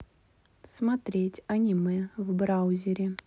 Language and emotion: Russian, neutral